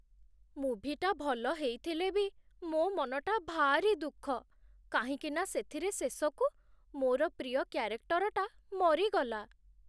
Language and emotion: Odia, sad